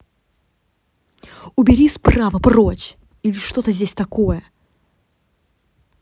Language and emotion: Russian, angry